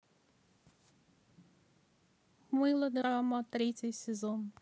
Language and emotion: Russian, neutral